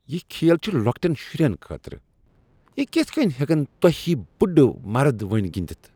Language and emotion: Kashmiri, disgusted